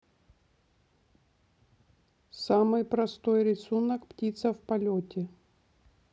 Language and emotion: Russian, neutral